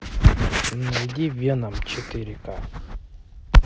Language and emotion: Russian, neutral